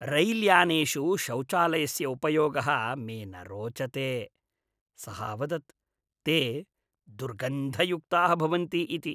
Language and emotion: Sanskrit, disgusted